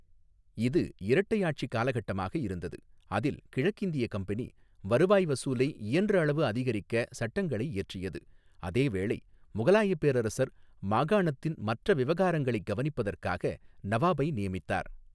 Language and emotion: Tamil, neutral